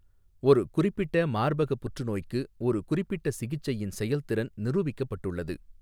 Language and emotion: Tamil, neutral